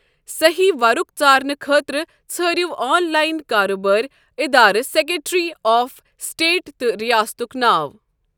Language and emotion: Kashmiri, neutral